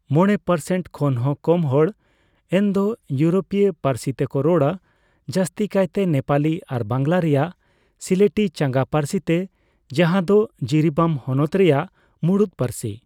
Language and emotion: Santali, neutral